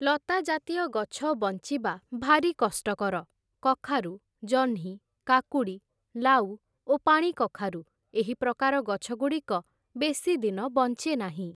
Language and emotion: Odia, neutral